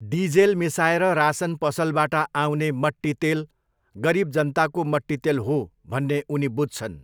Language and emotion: Nepali, neutral